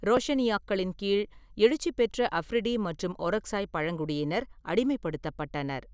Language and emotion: Tamil, neutral